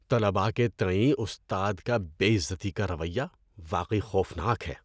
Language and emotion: Urdu, disgusted